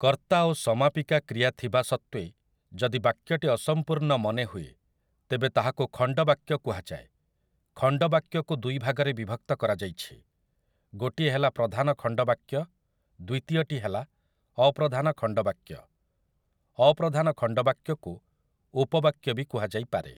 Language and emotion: Odia, neutral